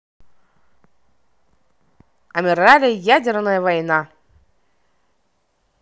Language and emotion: Russian, neutral